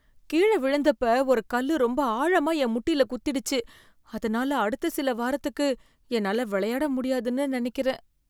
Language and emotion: Tamil, fearful